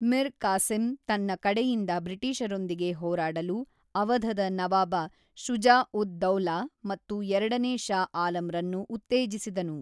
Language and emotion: Kannada, neutral